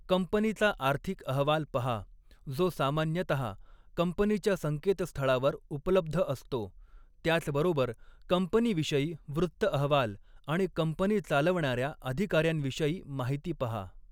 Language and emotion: Marathi, neutral